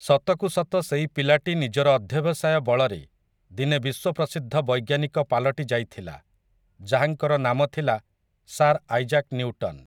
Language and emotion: Odia, neutral